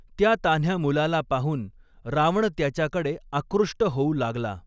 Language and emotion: Marathi, neutral